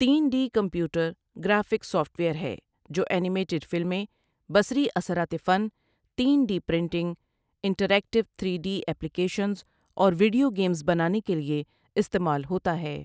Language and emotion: Urdu, neutral